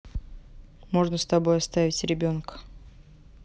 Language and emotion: Russian, neutral